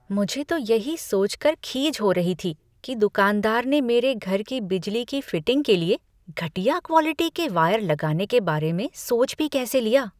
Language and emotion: Hindi, disgusted